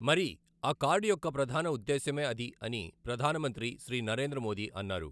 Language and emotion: Telugu, neutral